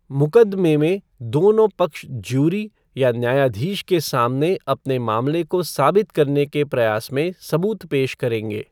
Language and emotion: Hindi, neutral